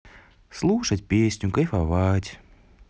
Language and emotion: Russian, positive